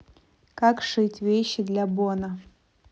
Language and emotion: Russian, neutral